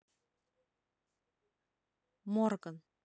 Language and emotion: Russian, neutral